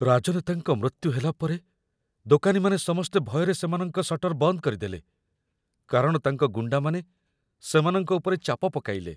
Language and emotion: Odia, fearful